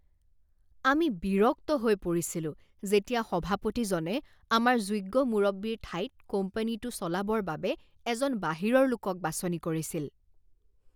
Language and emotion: Assamese, disgusted